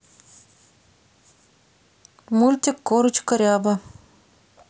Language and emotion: Russian, neutral